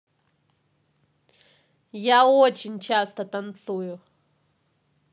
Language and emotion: Russian, positive